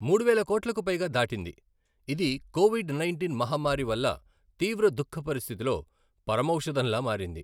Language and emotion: Telugu, neutral